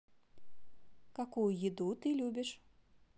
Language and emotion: Russian, positive